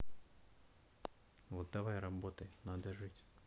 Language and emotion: Russian, neutral